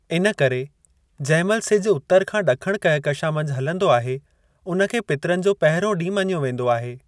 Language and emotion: Sindhi, neutral